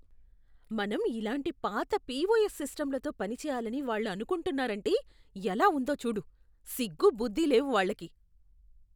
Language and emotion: Telugu, disgusted